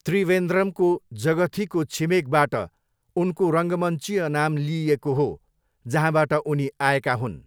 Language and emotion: Nepali, neutral